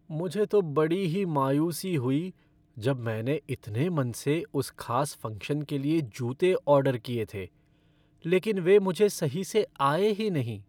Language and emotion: Hindi, sad